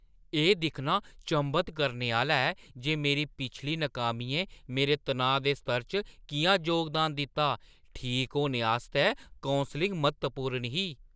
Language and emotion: Dogri, surprised